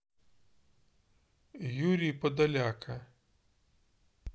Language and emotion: Russian, neutral